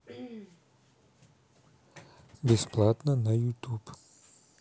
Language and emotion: Russian, neutral